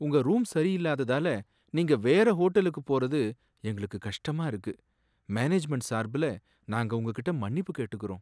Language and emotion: Tamil, sad